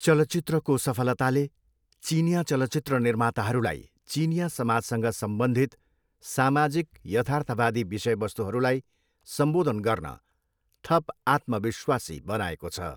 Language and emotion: Nepali, neutral